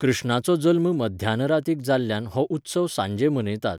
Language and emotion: Goan Konkani, neutral